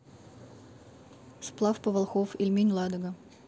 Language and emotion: Russian, neutral